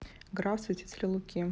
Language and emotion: Russian, neutral